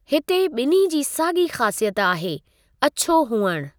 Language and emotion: Sindhi, neutral